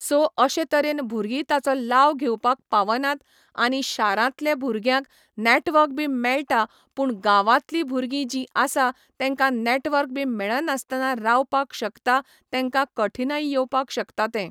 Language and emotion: Goan Konkani, neutral